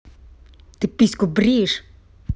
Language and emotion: Russian, angry